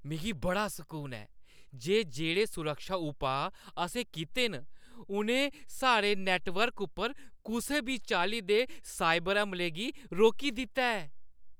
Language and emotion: Dogri, happy